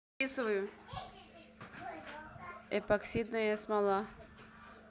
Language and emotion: Russian, neutral